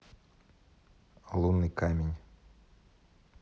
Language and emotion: Russian, neutral